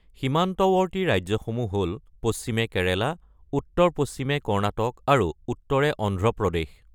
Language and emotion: Assamese, neutral